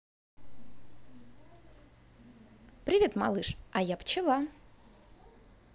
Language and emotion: Russian, positive